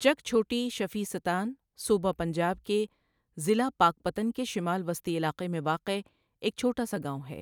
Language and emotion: Urdu, neutral